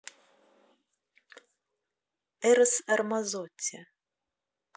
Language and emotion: Russian, neutral